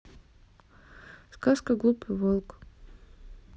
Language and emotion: Russian, neutral